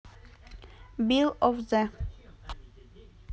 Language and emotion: Russian, neutral